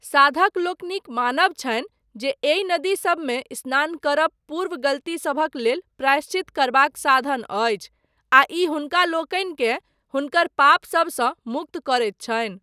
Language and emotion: Maithili, neutral